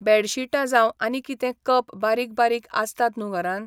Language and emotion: Goan Konkani, neutral